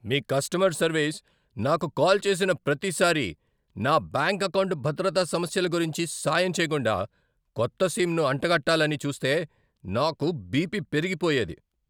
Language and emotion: Telugu, angry